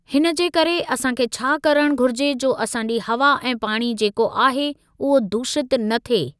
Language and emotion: Sindhi, neutral